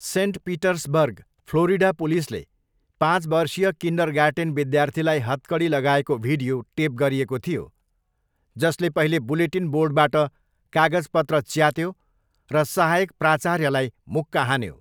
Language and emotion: Nepali, neutral